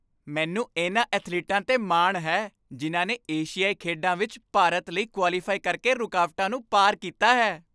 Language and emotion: Punjabi, happy